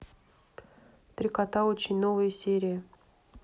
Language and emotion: Russian, neutral